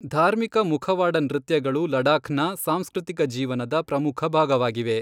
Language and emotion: Kannada, neutral